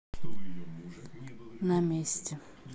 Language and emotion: Russian, neutral